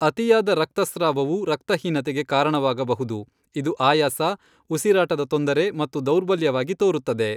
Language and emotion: Kannada, neutral